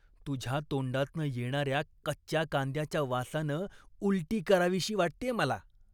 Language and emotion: Marathi, disgusted